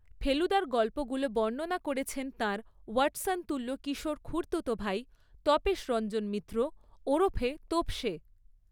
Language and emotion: Bengali, neutral